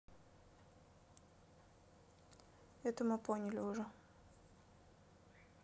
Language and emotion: Russian, neutral